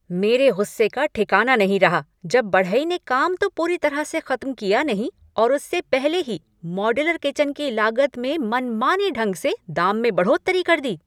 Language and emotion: Hindi, angry